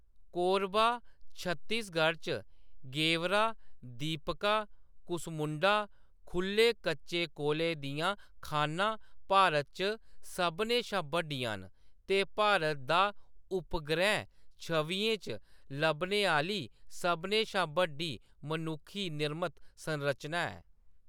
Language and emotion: Dogri, neutral